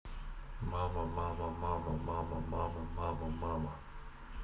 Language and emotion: Russian, neutral